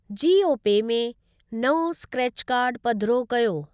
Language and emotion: Sindhi, neutral